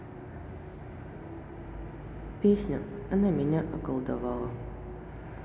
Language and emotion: Russian, sad